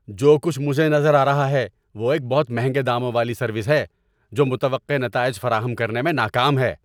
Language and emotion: Urdu, angry